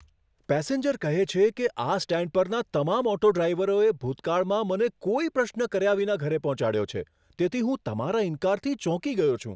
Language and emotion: Gujarati, surprised